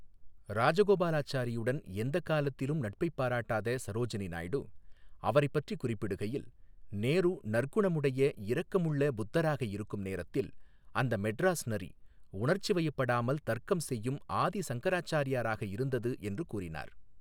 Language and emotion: Tamil, neutral